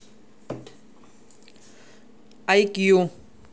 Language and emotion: Russian, neutral